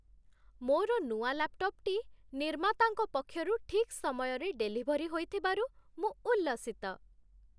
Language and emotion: Odia, happy